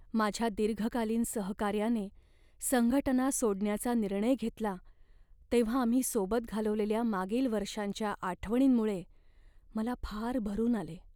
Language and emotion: Marathi, sad